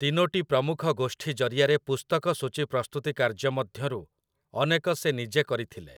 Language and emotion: Odia, neutral